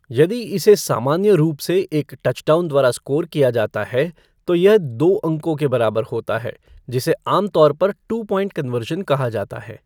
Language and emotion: Hindi, neutral